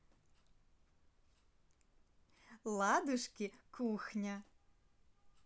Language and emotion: Russian, positive